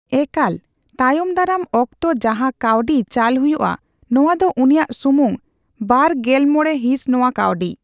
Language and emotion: Santali, neutral